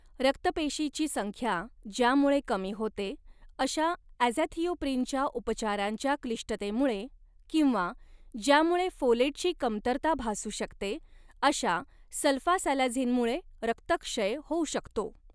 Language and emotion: Marathi, neutral